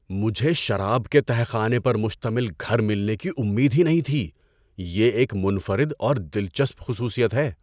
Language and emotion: Urdu, surprised